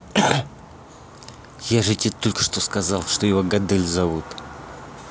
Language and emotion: Russian, angry